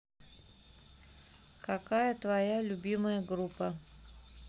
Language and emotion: Russian, neutral